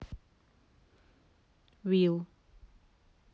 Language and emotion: Russian, neutral